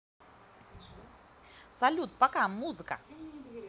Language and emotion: Russian, positive